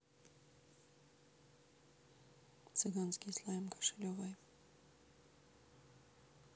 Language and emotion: Russian, neutral